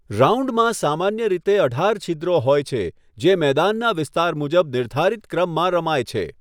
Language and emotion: Gujarati, neutral